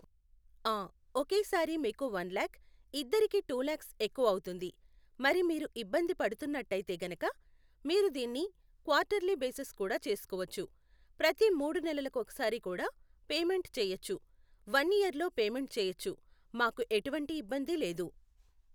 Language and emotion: Telugu, neutral